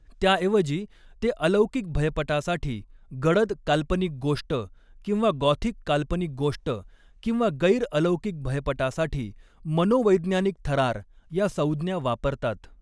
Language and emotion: Marathi, neutral